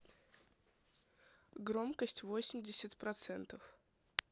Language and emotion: Russian, neutral